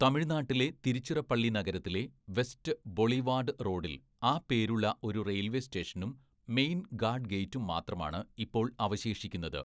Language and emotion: Malayalam, neutral